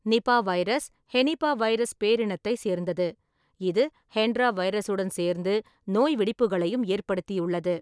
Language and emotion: Tamil, neutral